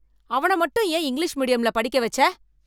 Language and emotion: Tamil, angry